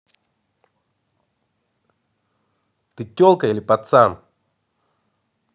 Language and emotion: Russian, angry